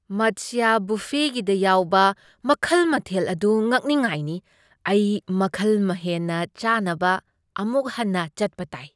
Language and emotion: Manipuri, surprised